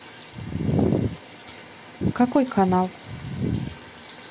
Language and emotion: Russian, neutral